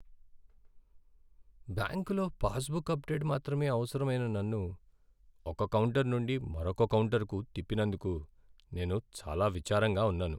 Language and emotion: Telugu, sad